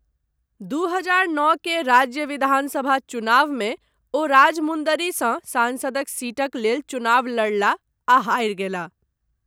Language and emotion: Maithili, neutral